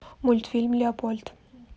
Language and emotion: Russian, neutral